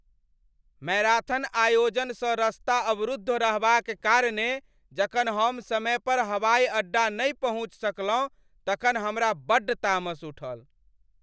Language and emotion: Maithili, angry